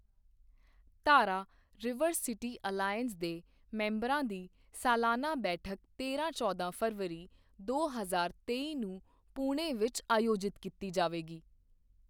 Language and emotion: Punjabi, neutral